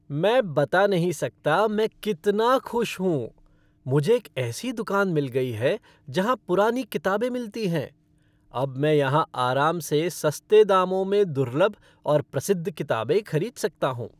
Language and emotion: Hindi, happy